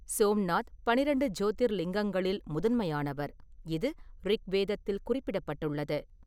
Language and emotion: Tamil, neutral